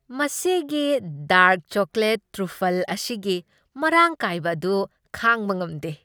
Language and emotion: Manipuri, happy